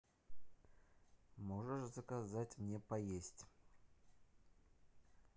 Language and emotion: Russian, neutral